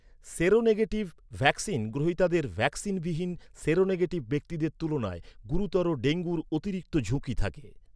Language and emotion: Bengali, neutral